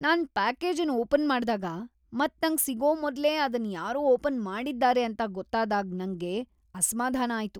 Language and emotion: Kannada, disgusted